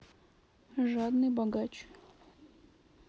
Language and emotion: Russian, neutral